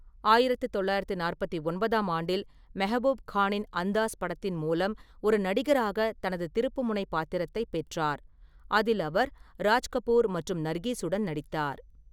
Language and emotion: Tamil, neutral